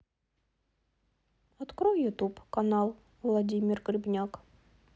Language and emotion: Russian, neutral